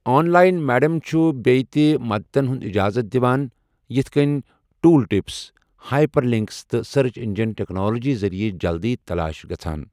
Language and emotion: Kashmiri, neutral